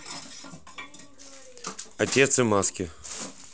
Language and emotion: Russian, neutral